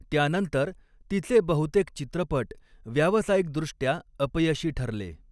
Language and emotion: Marathi, neutral